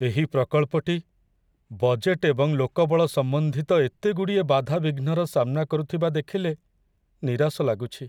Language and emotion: Odia, sad